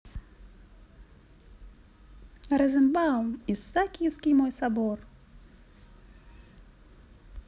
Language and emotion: Russian, positive